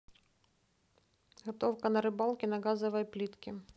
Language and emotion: Russian, neutral